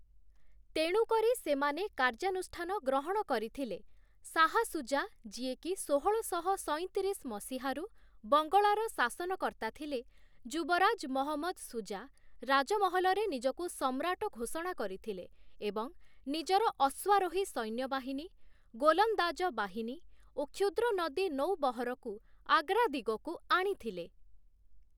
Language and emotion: Odia, neutral